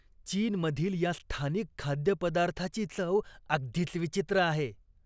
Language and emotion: Marathi, disgusted